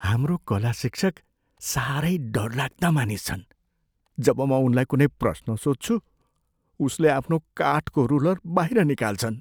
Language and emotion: Nepali, fearful